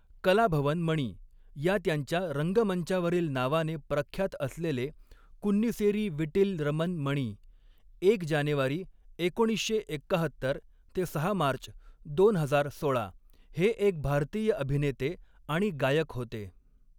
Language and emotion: Marathi, neutral